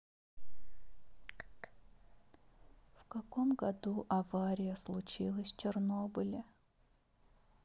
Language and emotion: Russian, sad